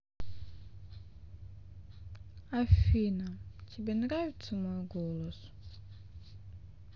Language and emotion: Russian, sad